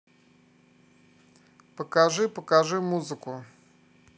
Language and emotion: Russian, neutral